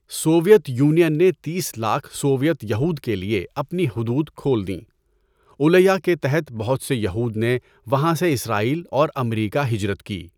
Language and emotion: Urdu, neutral